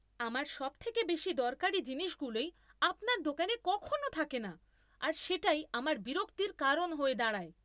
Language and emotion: Bengali, angry